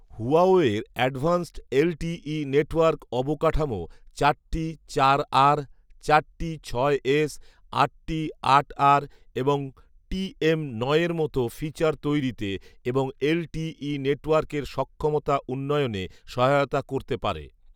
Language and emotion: Bengali, neutral